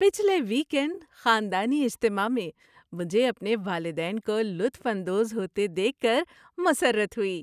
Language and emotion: Urdu, happy